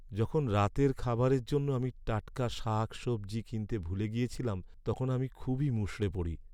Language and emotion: Bengali, sad